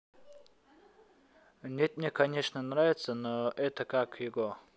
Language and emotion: Russian, neutral